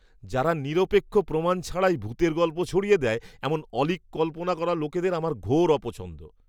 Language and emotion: Bengali, disgusted